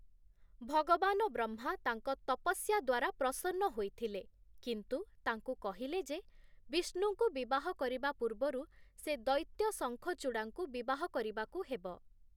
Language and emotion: Odia, neutral